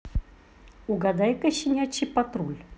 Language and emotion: Russian, positive